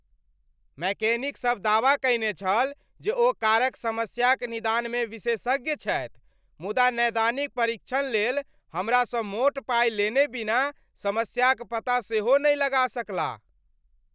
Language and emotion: Maithili, angry